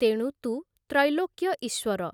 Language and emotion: Odia, neutral